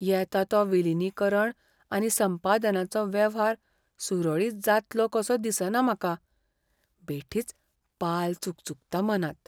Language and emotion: Goan Konkani, fearful